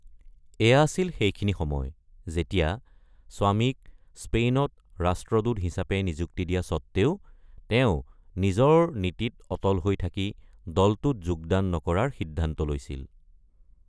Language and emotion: Assamese, neutral